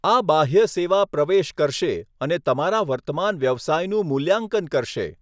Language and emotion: Gujarati, neutral